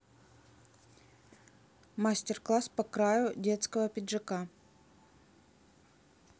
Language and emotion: Russian, neutral